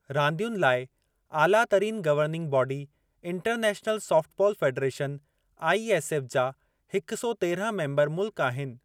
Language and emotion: Sindhi, neutral